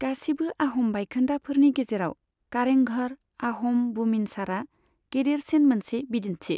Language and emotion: Bodo, neutral